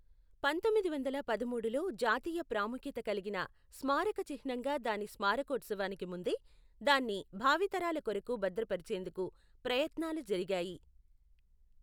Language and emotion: Telugu, neutral